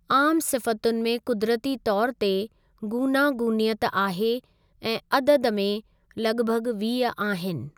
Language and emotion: Sindhi, neutral